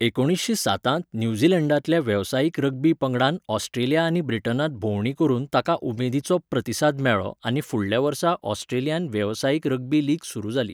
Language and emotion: Goan Konkani, neutral